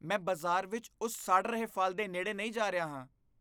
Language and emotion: Punjabi, disgusted